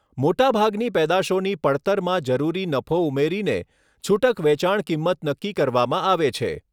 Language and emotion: Gujarati, neutral